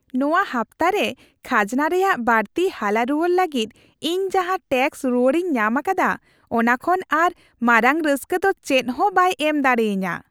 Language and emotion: Santali, happy